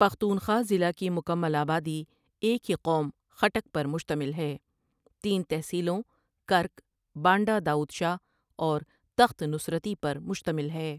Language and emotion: Urdu, neutral